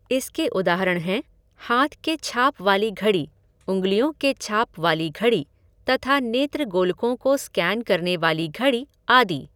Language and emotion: Hindi, neutral